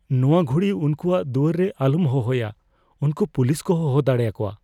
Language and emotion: Santali, fearful